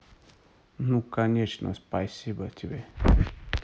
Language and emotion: Russian, neutral